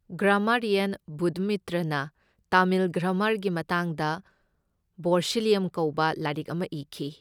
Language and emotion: Manipuri, neutral